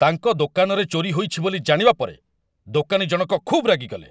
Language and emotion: Odia, angry